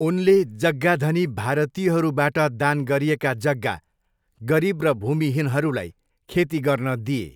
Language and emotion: Nepali, neutral